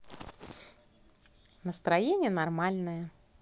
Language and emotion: Russian, positive